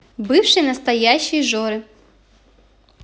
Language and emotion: Russian, neutral